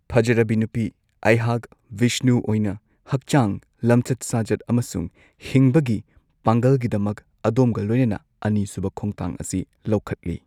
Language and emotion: Manipuri, neutral